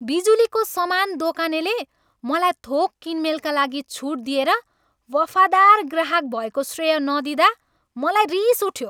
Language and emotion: Nepali, angry